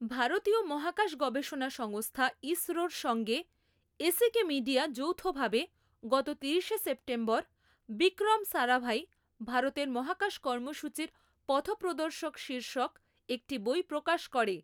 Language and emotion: Bengali, neutral